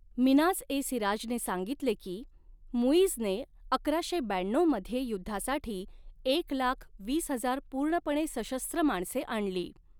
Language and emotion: Marathi, neutral